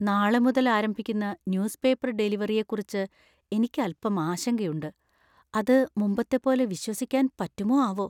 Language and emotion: Malayalam, fearful